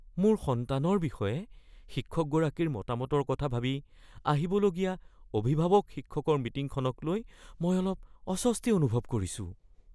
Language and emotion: Assamese, fearful